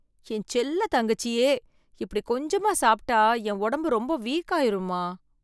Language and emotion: Tamil, fearful